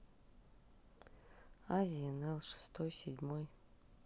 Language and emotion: Russian, neutral